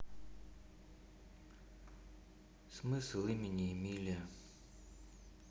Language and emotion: Russian, neutral